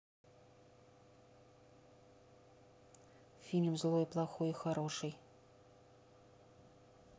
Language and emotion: Russian, neutral